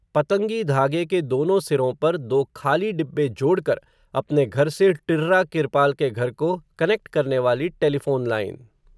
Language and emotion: Hindi, neutral